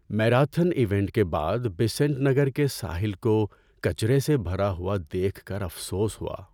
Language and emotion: Urdu, sad